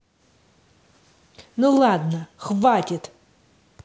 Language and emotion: Russian, angry